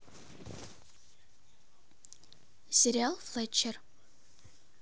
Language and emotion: Russian, neutral